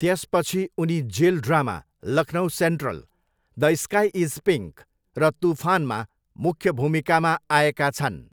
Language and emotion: Nepali, neutral